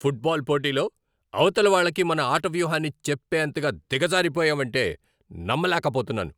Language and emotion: Telugu, angry